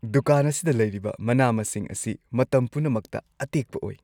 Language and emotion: Manipuri, happy